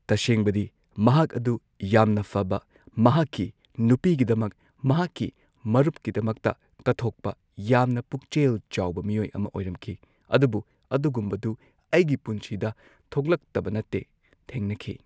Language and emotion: Manipuri, neutral